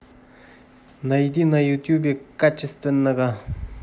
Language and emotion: Russian, neutral